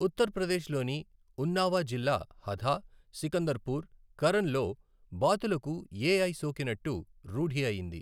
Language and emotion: Telugu, neutral